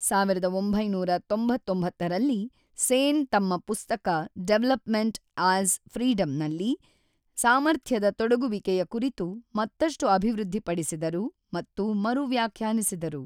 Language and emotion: Kannada, neutral